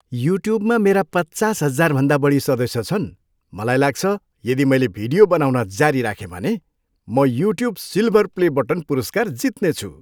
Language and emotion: Nepali, happy